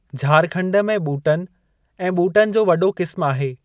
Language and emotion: Sindhi, neutral